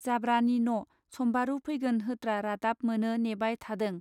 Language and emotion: Bodo, neutral